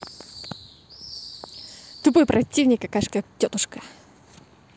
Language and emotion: Russian, neutral